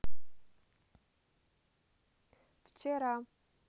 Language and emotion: Russian, neutral